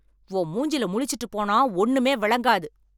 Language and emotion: Tamil, angry